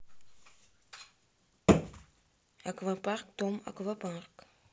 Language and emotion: Russian, neutral